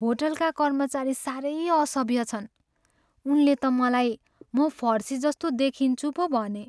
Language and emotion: Nepali, sad